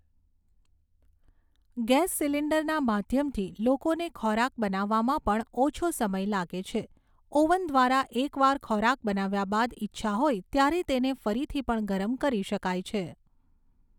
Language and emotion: Gujarati, neutral